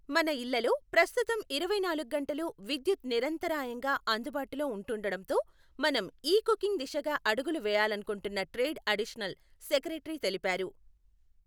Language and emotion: Telugu, neutral